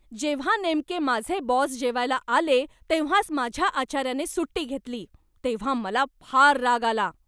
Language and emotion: Marathi, angry